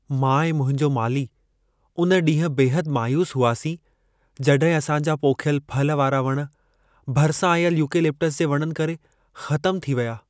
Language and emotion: Sindhi, sad